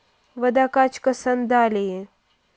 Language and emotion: Russian, neutral